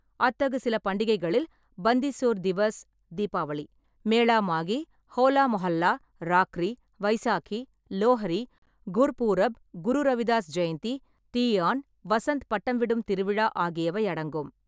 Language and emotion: Tamil, neutral